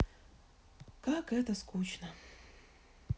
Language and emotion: Russian, sad